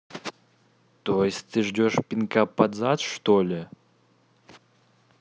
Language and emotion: Russian, angry